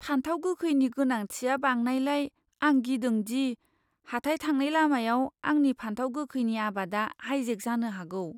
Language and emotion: Bodo, fearful